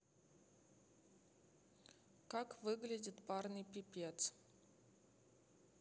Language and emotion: Russian, neutral